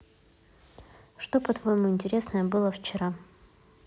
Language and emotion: Russian, neutral